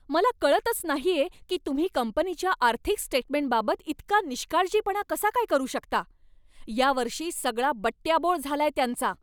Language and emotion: Marathi, angry